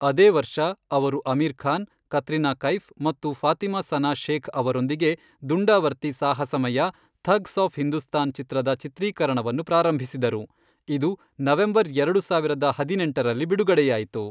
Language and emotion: Kannada, neutral